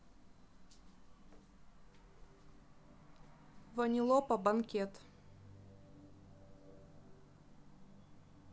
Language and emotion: Russian, neutral